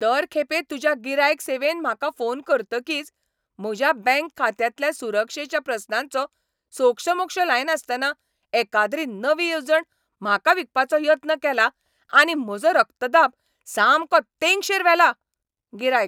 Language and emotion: Goan Konkani, angry